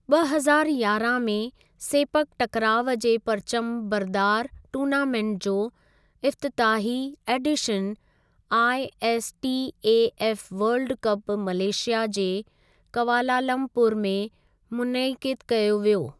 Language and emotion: Sindhi, neutral